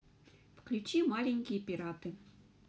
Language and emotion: Russian, neutral